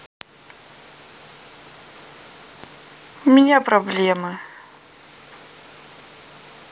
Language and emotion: Russian, sad